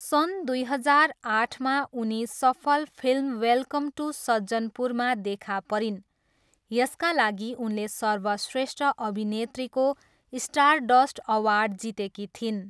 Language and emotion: Nepali, neutral